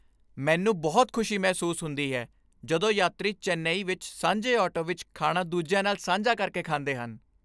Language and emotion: Punjabi, happy